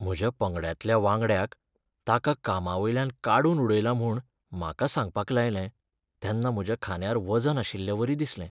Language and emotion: Goan Konkani, sad